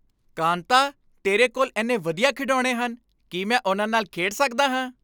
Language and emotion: Punjabi, happy